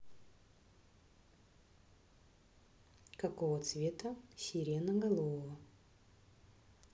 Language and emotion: Russian, neutral